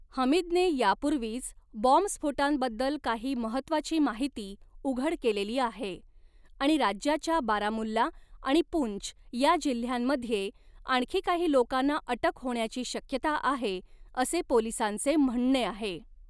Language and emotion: Marathi, neutral